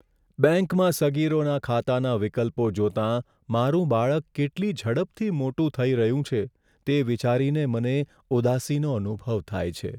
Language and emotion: Gujarati, sad